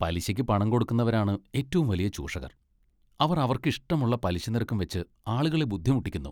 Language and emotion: Malayalam, disgusted